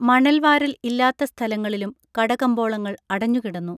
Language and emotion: Malayalam, neutral